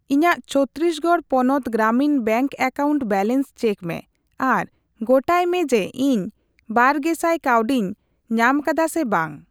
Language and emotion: Santali, neutral